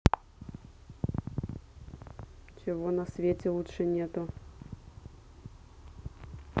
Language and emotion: Russian, neutral